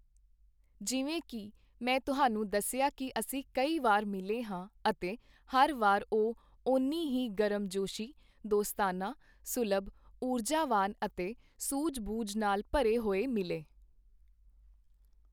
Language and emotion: Punjabi, neutral